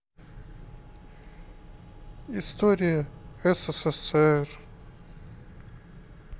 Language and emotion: Russian, sad